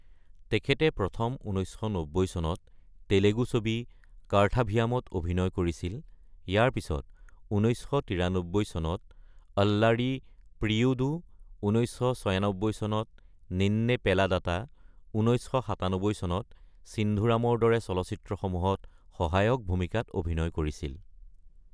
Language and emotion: Assamese, neutral